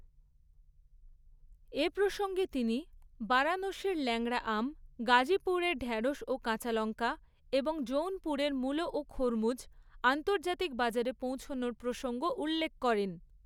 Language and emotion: Bengali, neutral